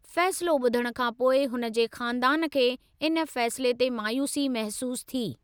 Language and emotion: Sindhi, neutral